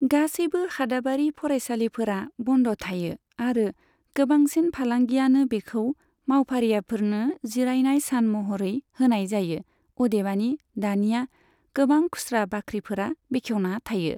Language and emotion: Bodo, neutral